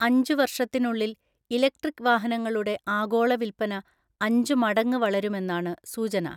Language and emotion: Malayalam, neutral